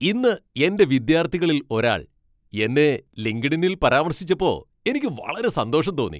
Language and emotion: Malayalam, happy